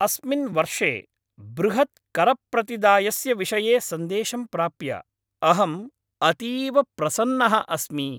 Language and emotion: Sanskrit, happy